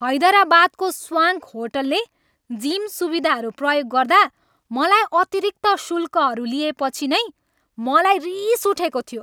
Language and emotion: Nepali, angry